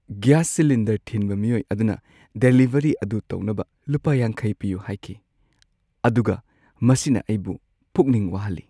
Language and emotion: Manipuri, sad